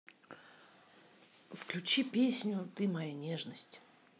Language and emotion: Russian, neutral